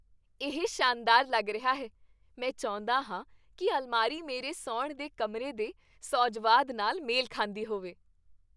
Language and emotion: Punjabi, happy